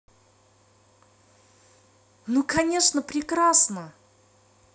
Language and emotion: Russian, positive